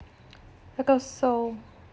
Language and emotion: Russian, neutral